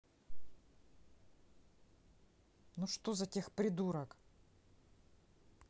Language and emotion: Russian, angry